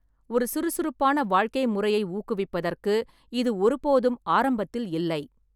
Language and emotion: Tamil, neutral